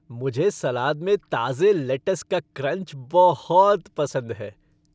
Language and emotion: Hindi, happy